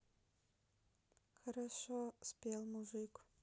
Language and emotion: Russian, sad